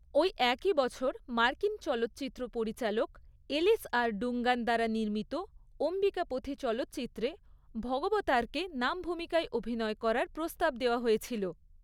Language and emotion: Bengali, neutral